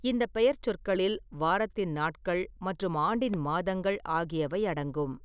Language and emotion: Tamil, neutral